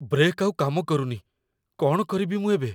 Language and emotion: Odia, fearful